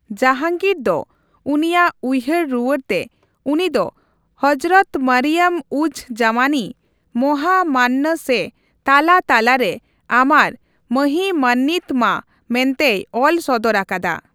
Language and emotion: Santali, neutral